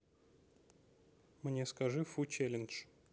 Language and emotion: Russian, neutral